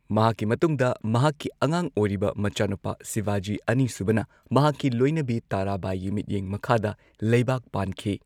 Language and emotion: Manipuri, neutral